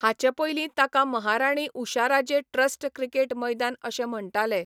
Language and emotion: Goan Konkani, neutral